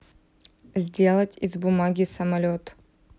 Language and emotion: Russian, neutral